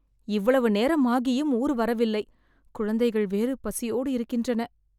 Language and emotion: Tamil, sad